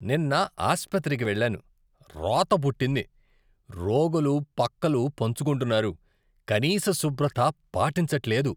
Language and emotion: Telugu, disgusted